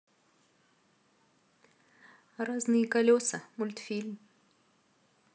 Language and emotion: Russian, neutral